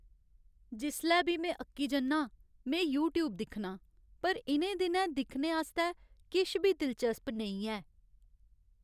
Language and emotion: Dogri, sad